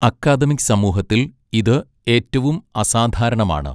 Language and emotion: Malayalam, neutral